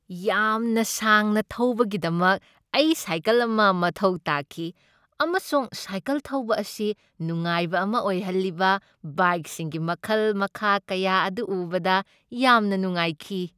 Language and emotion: Manipuri, happy